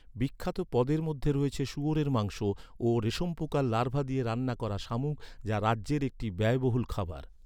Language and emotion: Bengali, neutral